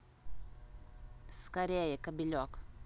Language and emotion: Russian, neutral